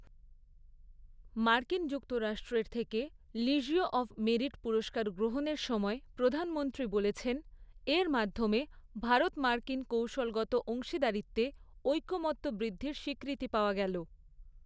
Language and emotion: Bengali, neutral